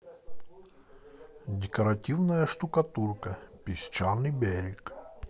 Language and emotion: Russian, positive